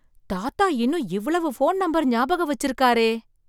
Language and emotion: Tamil, surprised